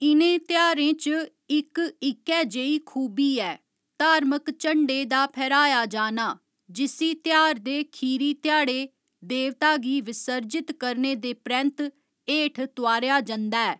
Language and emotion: Dogri, neutral